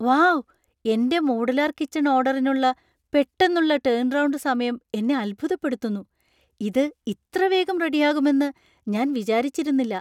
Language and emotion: Malayalam, surprised